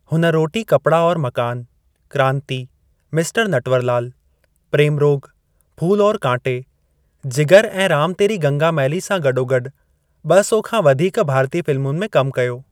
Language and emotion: Sindhi, neutral